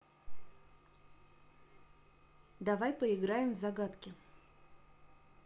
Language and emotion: Russian, neutral